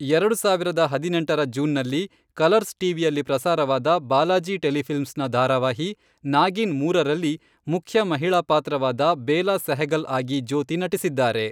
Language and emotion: Kannada, neutral